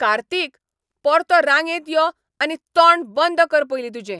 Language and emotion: Goan Konkani, angry